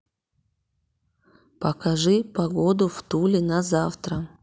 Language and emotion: Russian, neutral